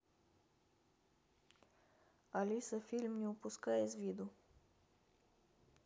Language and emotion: Russian, neutral